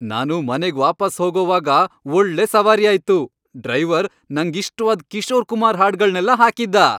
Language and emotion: Kannada, happy